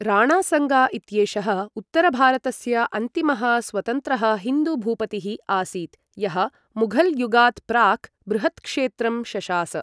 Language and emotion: Sanskrit, neutral